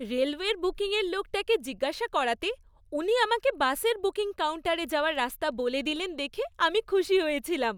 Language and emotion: Bengali, happy